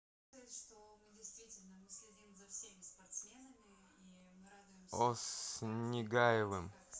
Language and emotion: Russian, neutral